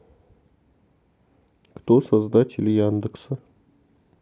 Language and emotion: Russian, neutral